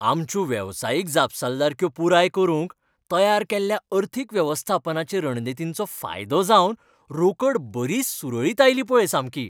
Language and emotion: Goan Konkani, happy